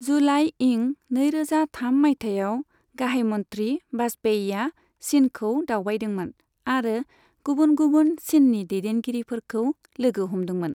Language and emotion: Bodo, neutral